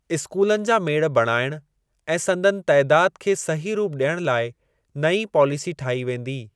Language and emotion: Sindhi, neutral